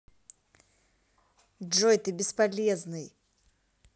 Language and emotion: Russian, angry